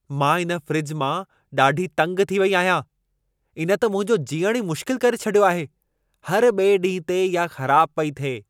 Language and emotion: Sindhi, angry